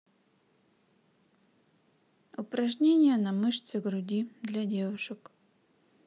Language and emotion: Russian, neutral